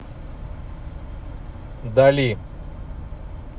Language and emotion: Russian, neutral